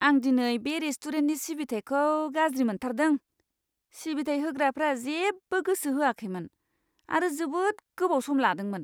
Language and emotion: Bodo, disgusted